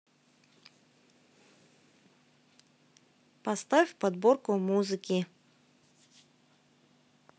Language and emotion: Russian, neutral